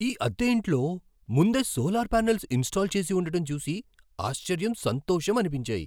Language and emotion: Telugu, surprised